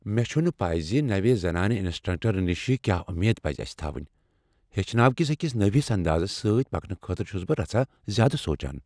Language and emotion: Kashmiri, fearful